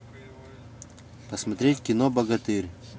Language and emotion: Russian, neutral